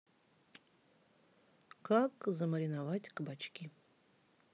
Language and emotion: Russian, neutral